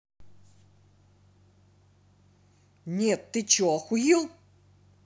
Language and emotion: Russian, angry